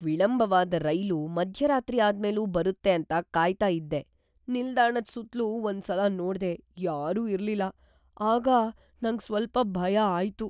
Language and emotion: Kannada, fearful